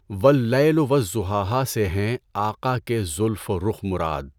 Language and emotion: Urdu, neutral